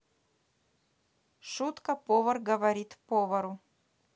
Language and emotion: Russian, neutral